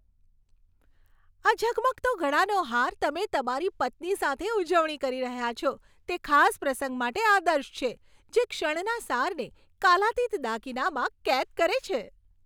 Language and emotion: Gujarati, happy